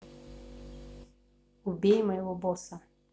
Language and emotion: Russian, neutral